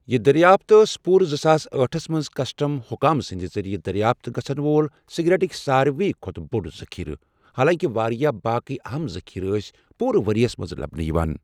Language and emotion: Kashmiri, neutral